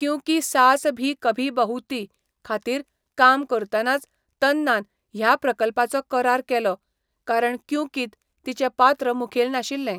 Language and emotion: Goan Konkani, neutral